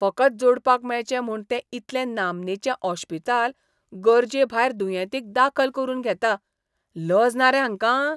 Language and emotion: Goan Konkani, disgusted